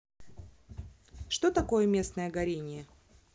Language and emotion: Russian, neutral